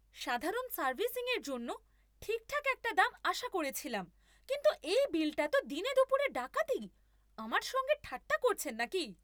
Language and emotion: Bengali, angry